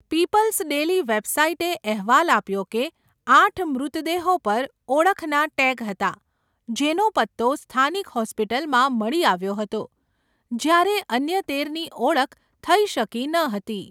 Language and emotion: Gujarati, neutral